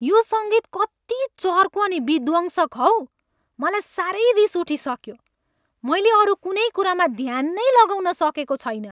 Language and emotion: Nepali, angry